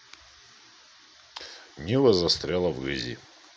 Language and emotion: Russian, neutral